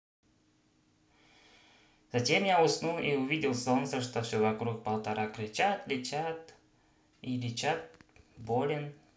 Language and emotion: Russian, positive